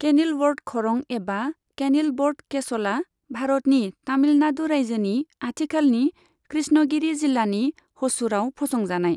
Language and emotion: Bodo, neutral